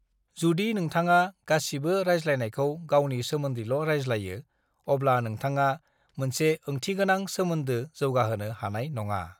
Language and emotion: Bodo, neutral